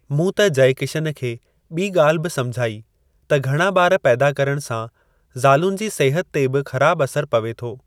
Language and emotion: Sindhi, neutral